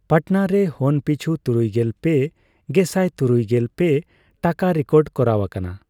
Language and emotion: Santali, neutral